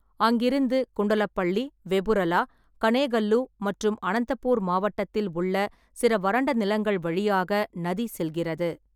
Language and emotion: Tamil, neutral